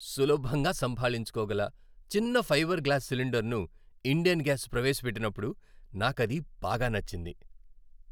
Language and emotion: Telugu, happy